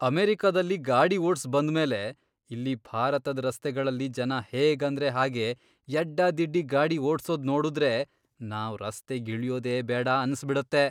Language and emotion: Kannada, disgusted